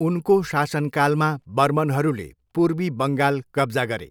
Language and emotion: Nepali, neutral